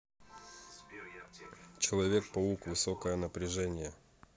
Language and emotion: Russian, neutral